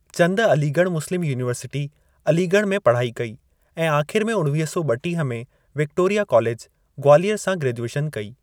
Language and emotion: Sindhi, neutral